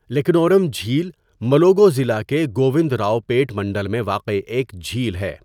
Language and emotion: Urdu, neutral